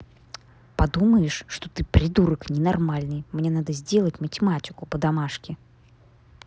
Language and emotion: Russian, angry